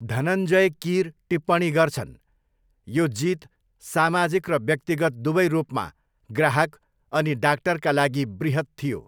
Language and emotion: Nepali, neutral